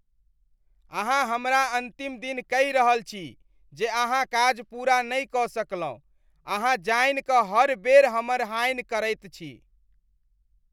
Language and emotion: Maithili, disgusted